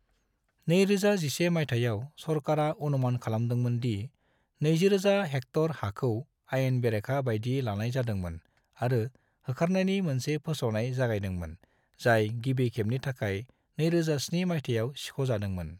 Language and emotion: Bodo, neutral